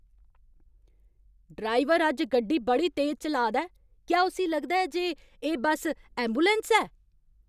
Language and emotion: Dogri, angry